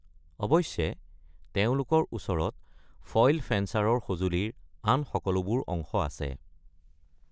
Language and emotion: Assamese, neutral